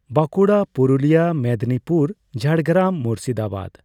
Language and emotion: Santali, neutral